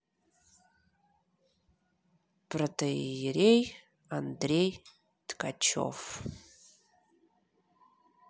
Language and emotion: Russian, neutral